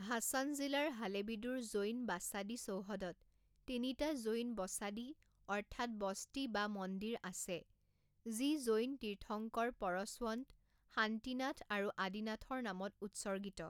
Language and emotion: Assamese, neutral